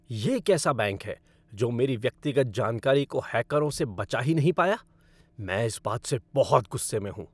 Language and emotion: Hindi, angry